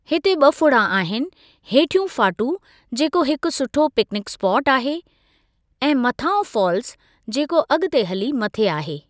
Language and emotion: Sindhi, neutral